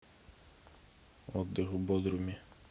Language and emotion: Russian, neutral